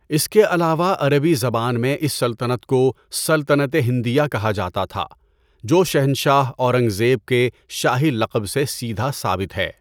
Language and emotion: Urdu, neutral